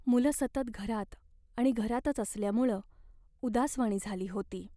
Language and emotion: Marathi, sad